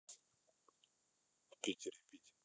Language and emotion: Russian, neutral